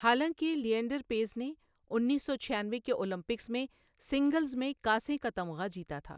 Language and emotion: Urdu, neutral